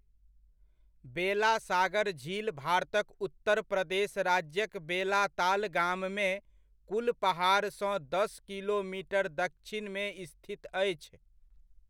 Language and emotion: Maithili, neutral